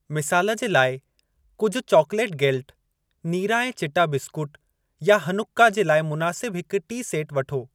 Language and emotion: Sindhi, neutral